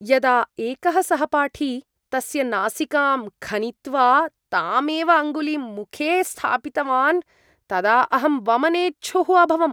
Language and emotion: Sanskrit, disgusted